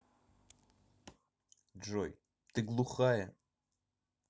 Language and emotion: Russian, angry